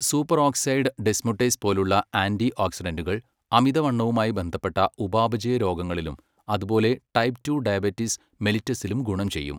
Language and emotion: Malayalam, neutral